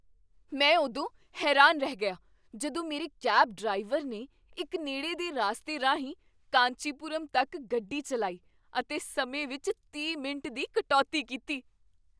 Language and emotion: Punjabi, surprised